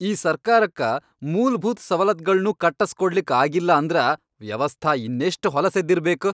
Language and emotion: Kannada, angry